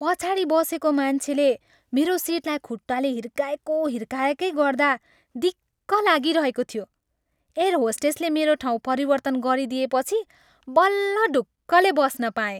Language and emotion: Nepali, happy